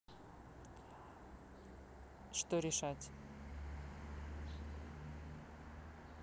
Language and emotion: Russian, neutral